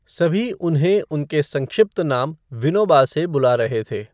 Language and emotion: Hindi, neutral